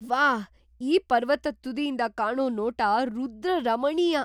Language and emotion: Kannada, surprised